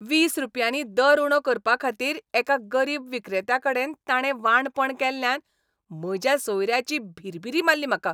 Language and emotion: Goan Konkani, angry